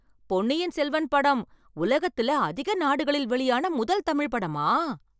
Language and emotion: Tamil, surprised